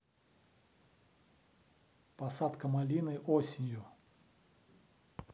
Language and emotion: Russian, neutral